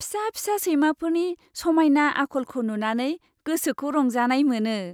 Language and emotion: Bodo, happy